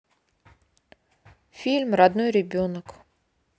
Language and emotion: Russian, neutral